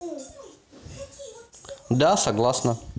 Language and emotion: Russian, neutral